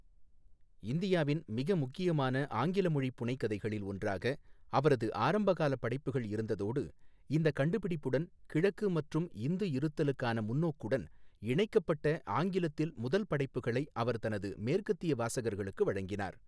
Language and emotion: Tamil, neutral